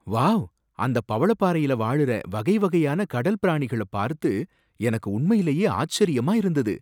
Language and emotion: Tamil, surprised